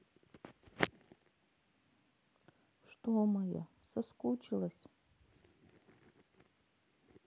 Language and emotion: Russian, sad